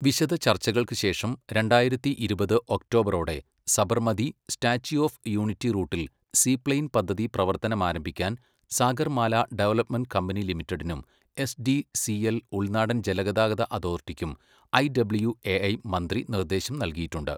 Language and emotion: Malayalam, neutral